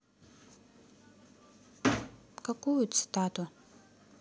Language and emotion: Russian, neutral